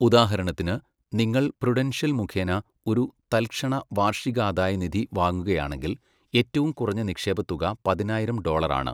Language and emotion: Malayalam, neutral